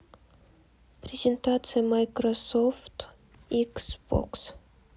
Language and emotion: Russian, neutral